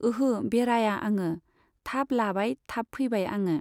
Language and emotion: Bodo, neutral